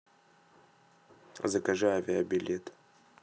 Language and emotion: Russian, neutral